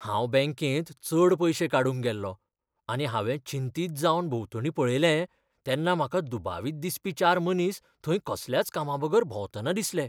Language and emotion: Goan Konkani, fearful